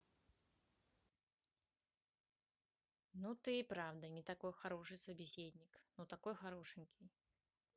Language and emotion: Russian, neutral